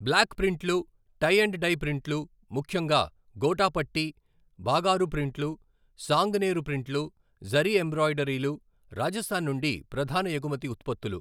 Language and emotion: Telugu, neutral